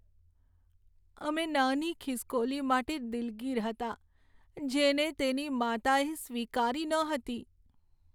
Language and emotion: Gujarati, sad